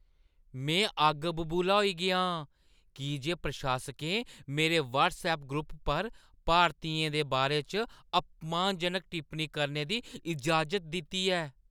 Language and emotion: Dogri, angry